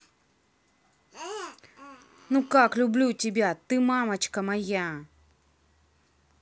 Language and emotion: Russian, neutral